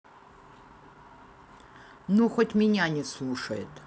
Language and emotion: Russian, neutral